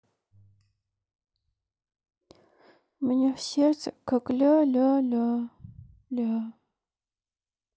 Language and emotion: Russian, sad